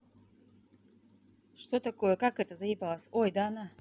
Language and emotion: Russian, neutral